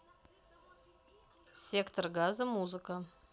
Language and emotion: Russian, neutral